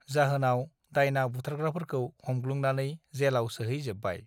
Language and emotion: Bodo, neutral